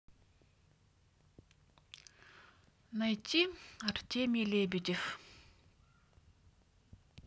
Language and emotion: Russian, sad